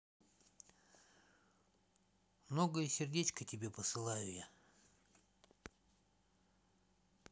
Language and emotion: Russian, neutral